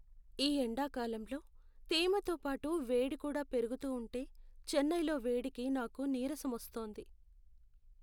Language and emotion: Telugu, sad